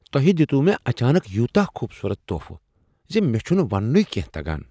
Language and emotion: Kashmiri, surprised